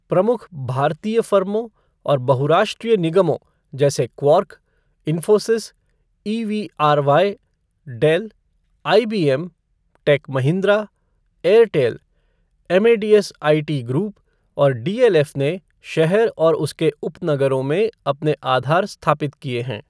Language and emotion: Hindi, neutral